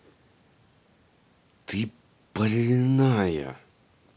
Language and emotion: Russian, angry